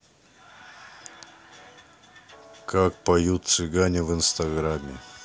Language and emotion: Russian, neutral